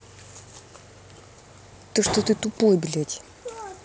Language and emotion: Russian, angry